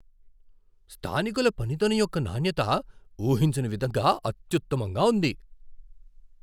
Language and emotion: Telugu, surprised